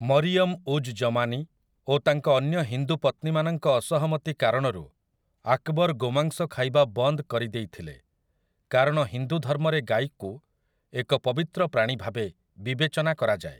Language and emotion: Odia, neutral